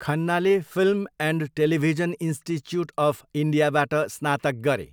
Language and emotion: Nepali, neutral